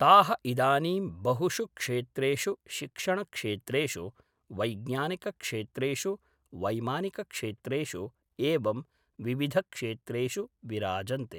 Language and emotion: Sanskrit, neutral